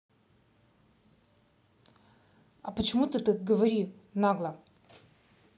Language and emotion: Russian, angry